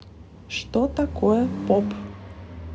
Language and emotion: Russian, neutral